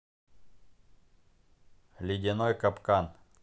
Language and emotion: Russian, neutral